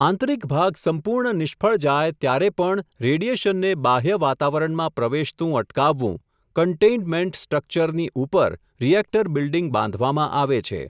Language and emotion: Gujarati, neutral